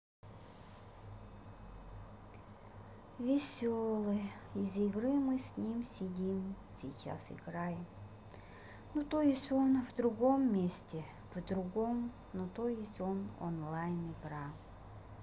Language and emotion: Russian, sad